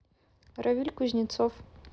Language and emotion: Russian, neutral